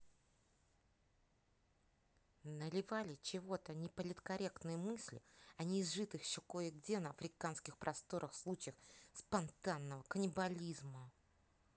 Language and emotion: Russian, angry